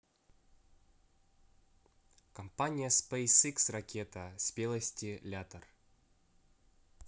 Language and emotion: Russian, neutral